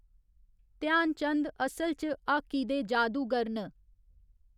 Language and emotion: Dogri, neutral